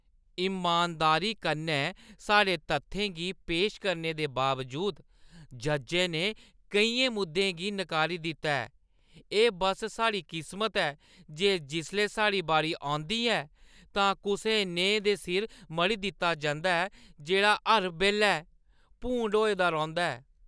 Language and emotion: Dogri, disgusted